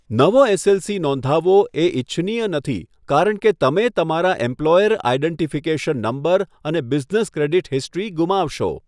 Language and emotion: Gujarati, neutral